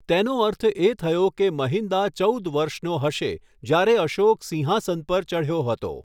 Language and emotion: Gujarati, neutral